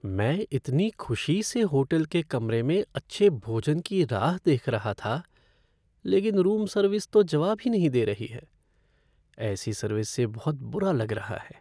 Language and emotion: Hindi, sad